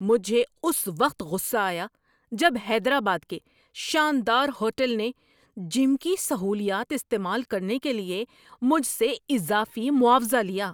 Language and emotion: Urdu, angry